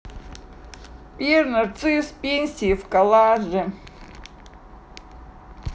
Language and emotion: Russian, sad